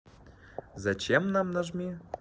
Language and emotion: Russian, positive